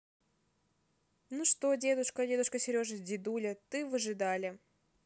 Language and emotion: Russian, neutral